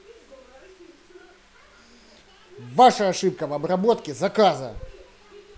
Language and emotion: Russian, angry